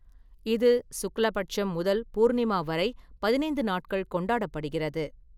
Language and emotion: Tamil, neutral